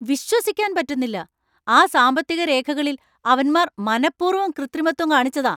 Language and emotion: Malayalam, angry